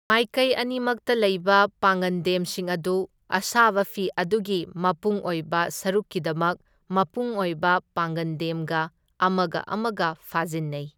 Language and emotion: Manipuri, neutral